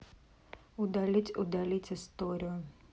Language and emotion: Russian, neutral